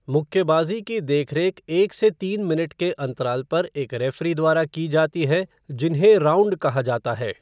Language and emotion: Hindi, neutral